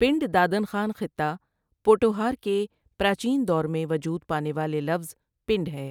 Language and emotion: Urdu, neutral